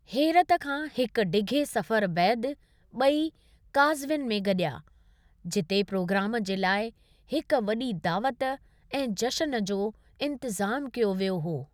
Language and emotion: Sindhi, neutral